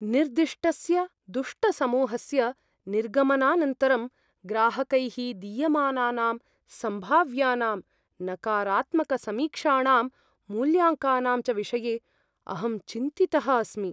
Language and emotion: Sanskrit, fearful